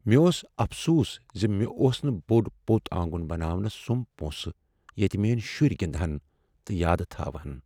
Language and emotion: Kashmiri, sad